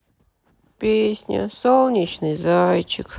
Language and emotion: Russian, sad